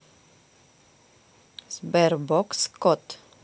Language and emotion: Russian, neutral